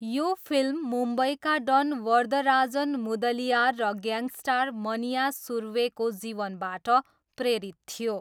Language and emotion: Nepali, neutral